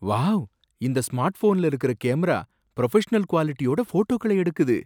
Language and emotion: Tamil, surprised